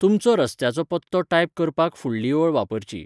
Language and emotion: Goan Konkani, neutral